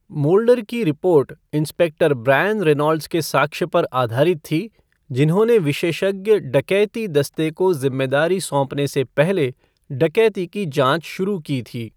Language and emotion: Hindi, neutral